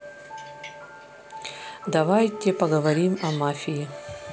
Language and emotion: Russian, neutral